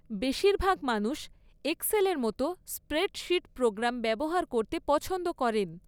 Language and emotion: Bengali, neutral